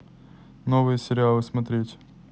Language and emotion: Russian, neutral